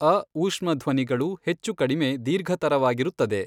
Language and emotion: Kannada, neutral